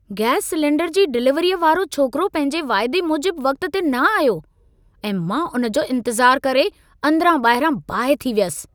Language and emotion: Sindhi, angry